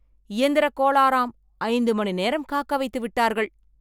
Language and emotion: Tamil, angry